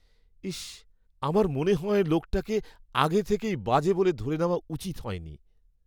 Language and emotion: Bengali, sad